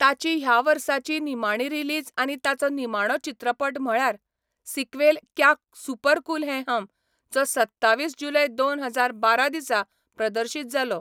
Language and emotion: Goan Konkani, neutral